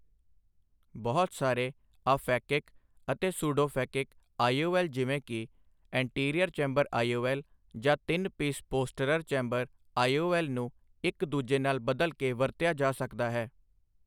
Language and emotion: Punjabi, neutral